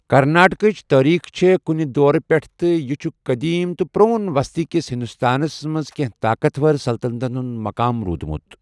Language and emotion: Kashmiri, neutral